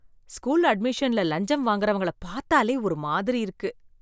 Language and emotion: Tamil, disgusted